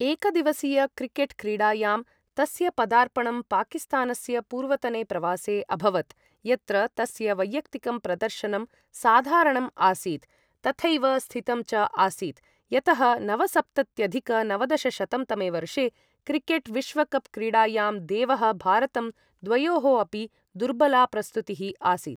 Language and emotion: Sanskrit, neutral